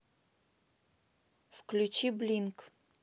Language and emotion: Russian, neutral